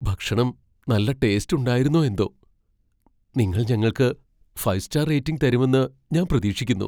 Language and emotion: Malayalam, fearful